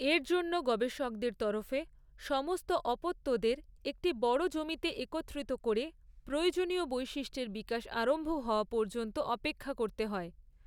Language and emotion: Bengali, neutral